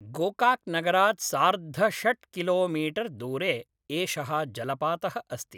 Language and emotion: Sanskrit, neutral